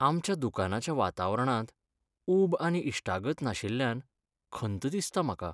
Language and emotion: Goan Konkani, sad